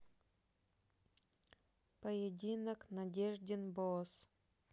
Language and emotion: Russian, neutral